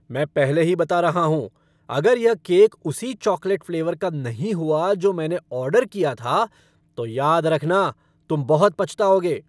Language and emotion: Hindi, angry